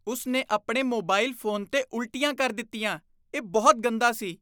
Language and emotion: Punjabi, disgusted